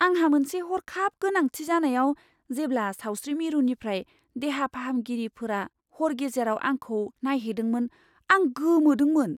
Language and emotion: Bodo, surprised